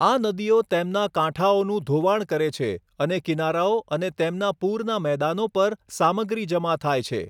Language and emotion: Gujarati, neutral